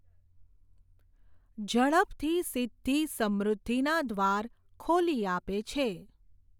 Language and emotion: Gujarati, neutral